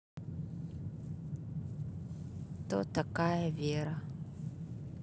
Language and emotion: Russian, sad